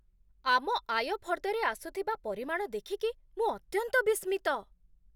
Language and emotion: Odia, surprised